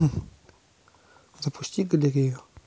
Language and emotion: Russian, neutral